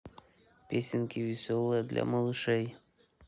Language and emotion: Russian, neutral